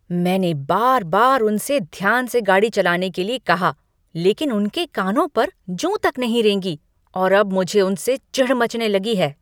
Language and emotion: Hindi, angry